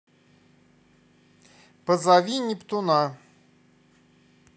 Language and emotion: Russian, positive